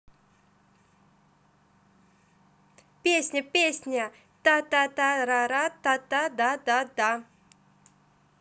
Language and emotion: Russian, positive